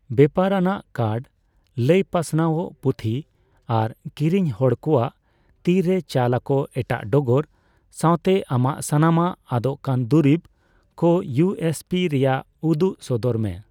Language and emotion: Santali, neutral